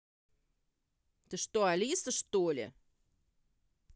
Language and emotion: Russian, angry